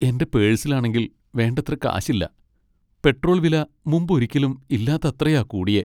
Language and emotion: Malayalam, sad